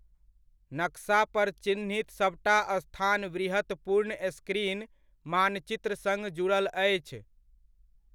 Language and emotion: Maithili, neutral